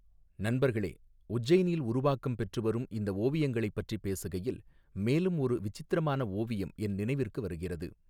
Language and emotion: Tamil, neutral